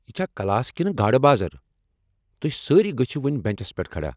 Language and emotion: Kashmiri, angry